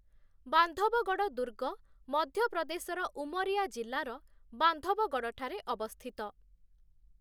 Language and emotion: Odia, neutral